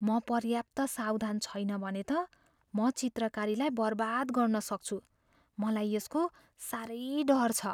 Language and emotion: Nepali, fearful